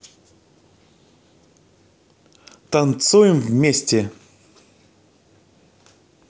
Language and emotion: Russian, positive